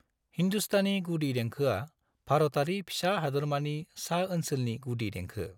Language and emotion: Bodo, neutral